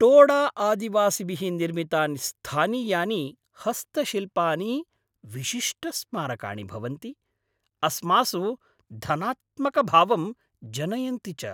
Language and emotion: Sanskrit, happy